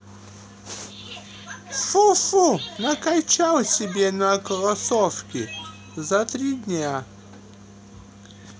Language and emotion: Russian, neutral